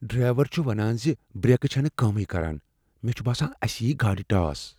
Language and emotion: Kashmiri, fearful